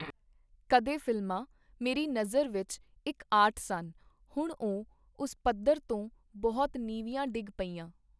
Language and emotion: Punjabi, neutral